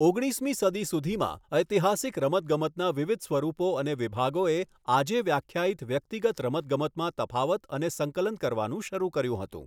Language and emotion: Gujarati, neutral